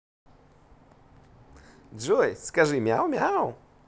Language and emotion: Russian, positive